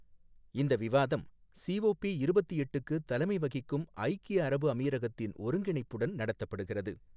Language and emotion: Tamil, neutral